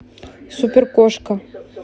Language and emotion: Russian, neutral